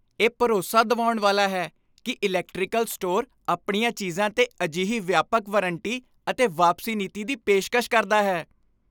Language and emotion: Punjabi, happy